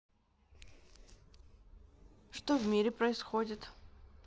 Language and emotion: Russian, neutral